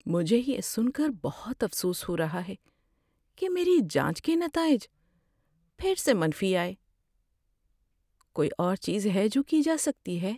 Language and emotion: Urdu, sad